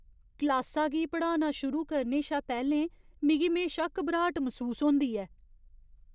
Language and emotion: Dogri, fearful